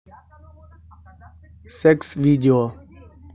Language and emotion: Russian, neutral